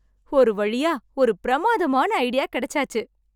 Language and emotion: Tamil, happy